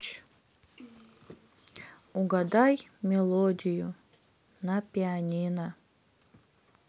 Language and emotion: Russian, sad